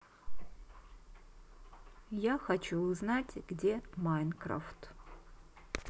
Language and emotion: Russian, neutral